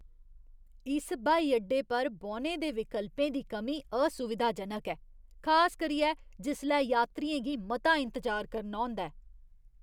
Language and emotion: Dogri, disgusted